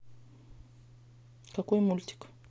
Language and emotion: Russian, neutral